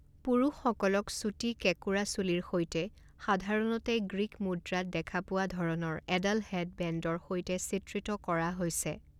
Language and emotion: Assamese, neutral